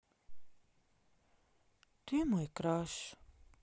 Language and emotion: Russian, sad